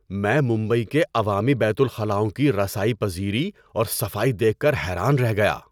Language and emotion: Urdu, surprised